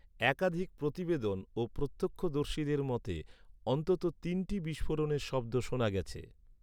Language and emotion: Bengali, neutral